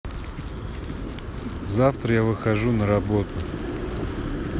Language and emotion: Russian, neutral